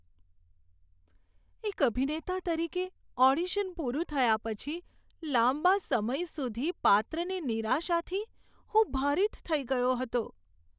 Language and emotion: Gujarati, sad